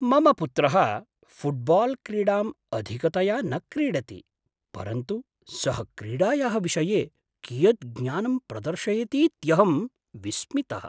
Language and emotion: Sanskrit, surprised